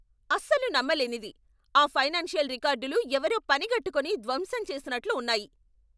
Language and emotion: Telugu, angry